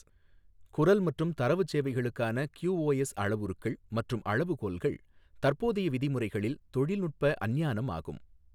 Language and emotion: Tamil, neutral